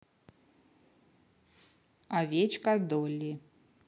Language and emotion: Russian, neutral